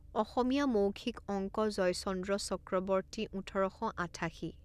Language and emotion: Assamese, neutral